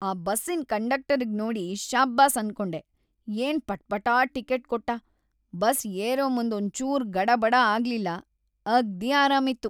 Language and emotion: Kannada, happy